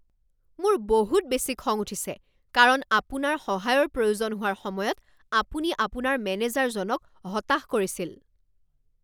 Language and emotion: Assamese, angry